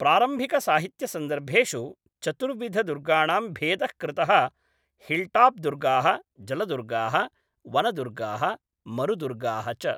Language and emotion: Sanskrit, neutral